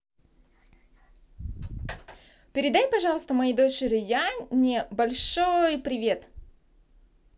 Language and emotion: Russian, positive